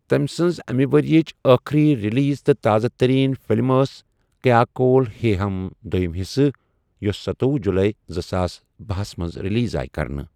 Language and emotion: Kashmiri, neutral